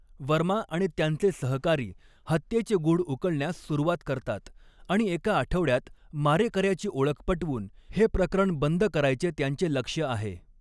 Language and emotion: Marathi, neutral